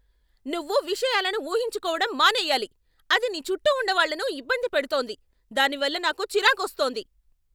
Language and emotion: Telugu, angry